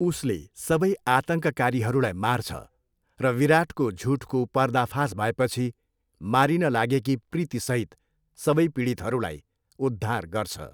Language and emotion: Nepali, neutral